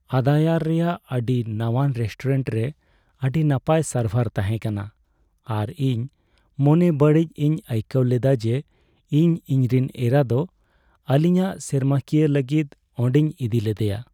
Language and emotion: Santali, sad